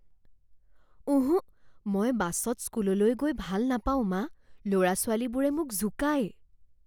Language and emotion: Assamese, fearful